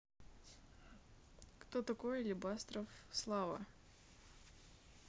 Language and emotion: Russian, neutral